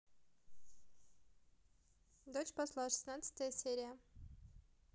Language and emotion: Russian, neutral